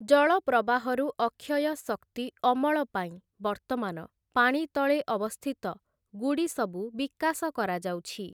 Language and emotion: Odia, neutral